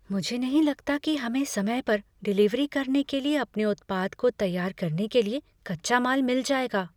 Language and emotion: Hindi, fearful